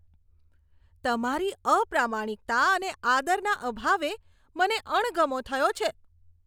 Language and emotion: Gujarati, disgusted